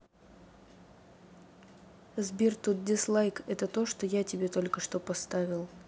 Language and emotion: Russian, neutral